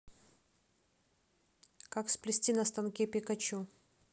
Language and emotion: Russian, neutral